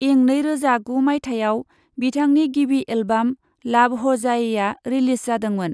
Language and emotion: Bodo, neutral